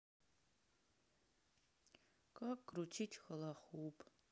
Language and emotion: Russian, sad